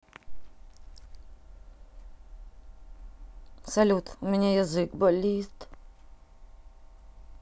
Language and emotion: Russian, sad